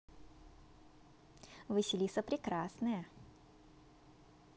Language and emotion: Russian, positive